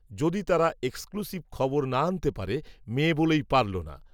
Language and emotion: Bengali, neutral